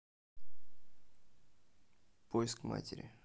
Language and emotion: Russian, neutral